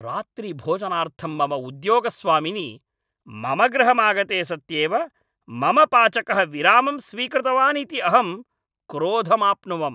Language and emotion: Sanskrit, angry